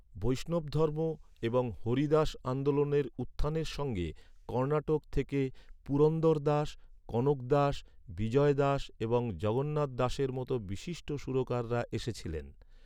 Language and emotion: Bengali, neutral